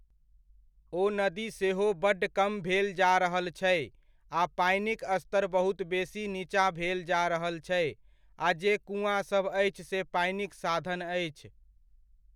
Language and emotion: Maithili, neutral